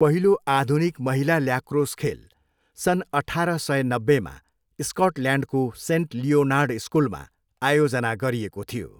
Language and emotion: Nepali, neutral